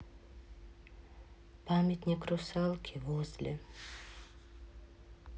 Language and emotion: Russian, sad